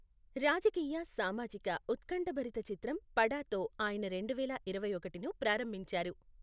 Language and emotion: Telugu, neutral